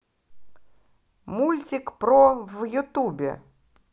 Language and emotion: Russian, positive